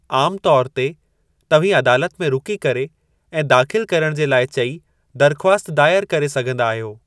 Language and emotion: Sindhi, neutral